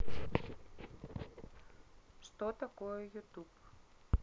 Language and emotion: Russian, neutral